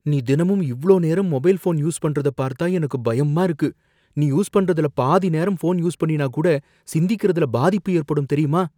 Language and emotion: Tamil, fearful